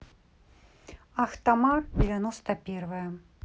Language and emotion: Russian, neutral